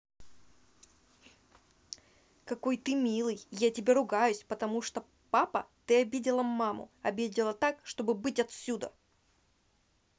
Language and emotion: Russian, angry